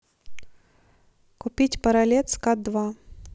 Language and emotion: Russian, neutral